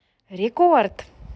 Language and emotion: Russian, positive